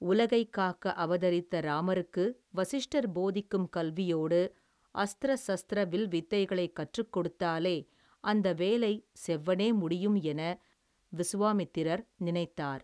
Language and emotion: Tamil, neutral